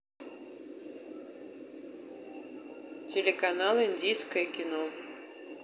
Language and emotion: Russian, neutral